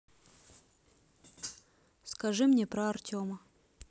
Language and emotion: Russian, neutral